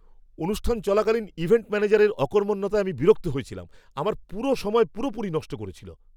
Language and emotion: Bengali, angry